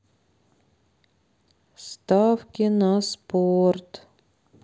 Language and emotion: Russian, sad